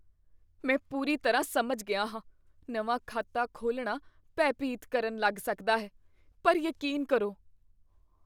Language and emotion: Punjabi, fearful